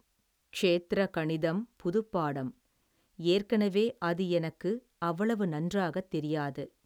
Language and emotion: Tamil, neutral